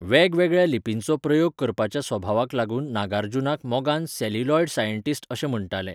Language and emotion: Goan Konkani, neutral